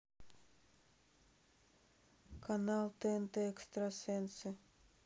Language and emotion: Russian, neutral